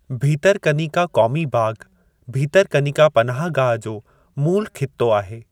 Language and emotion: Sindhi, neutral